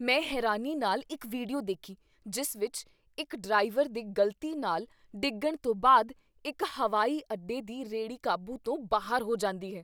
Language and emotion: Punjabi, surprised